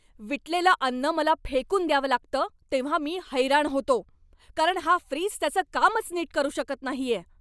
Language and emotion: Marathi, angry